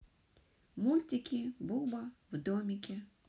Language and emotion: Russian, neutral